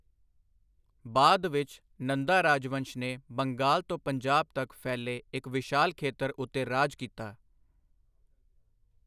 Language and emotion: Punjabi, neutral